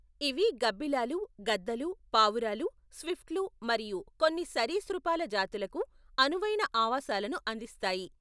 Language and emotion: Telugu, neutral